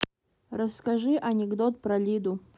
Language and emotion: Russian, neutral